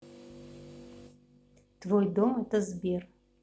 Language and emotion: Russian, neutral